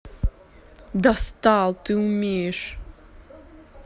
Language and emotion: Russian, angry